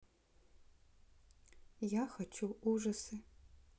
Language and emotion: Russian, neutral